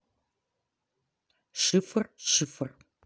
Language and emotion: Russian, neutral